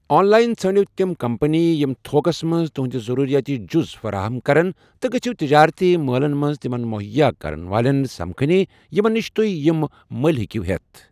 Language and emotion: Kashmiri, neutral